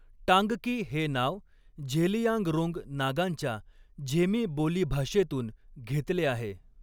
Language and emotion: Marathi, neutral